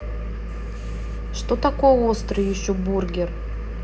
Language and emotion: Russian, neutral